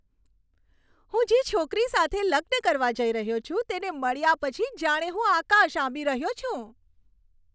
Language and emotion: Gujarati, happy